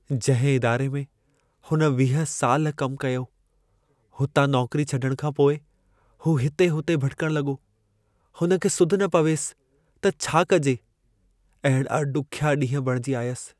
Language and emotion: Sindhi, sad